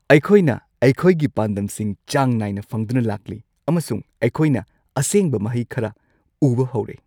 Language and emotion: Manipuri, happy